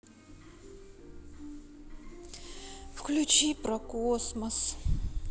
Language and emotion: Russian, sad